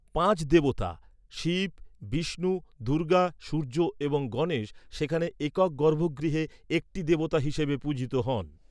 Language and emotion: Bengali, neutral